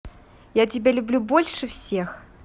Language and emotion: Russian, positive